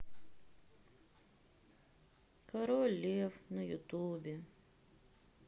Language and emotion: Russian, sad